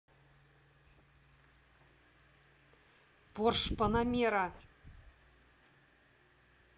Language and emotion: Russian, neutral